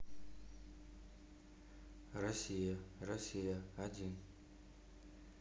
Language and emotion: Russian, neutral